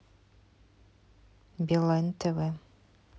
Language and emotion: Russian, neutral